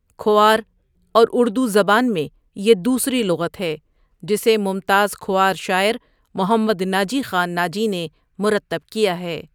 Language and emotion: Urdu, neutral